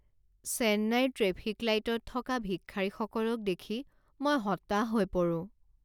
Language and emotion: Assamese, sad